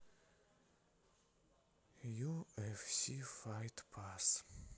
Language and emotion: Russian, sad